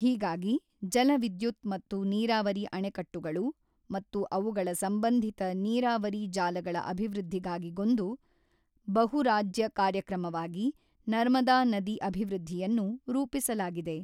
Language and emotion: Kannada, neutral